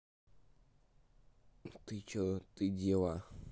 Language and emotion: Russian, neutral